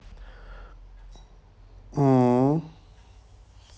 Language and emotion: Russian, neutral